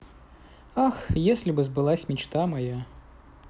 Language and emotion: Russian, sad